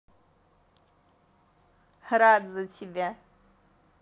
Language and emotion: Russian, positive